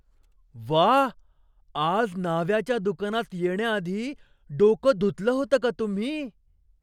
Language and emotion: Marathi, surprised